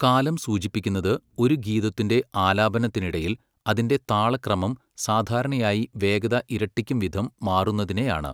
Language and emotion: Malayalam, neutral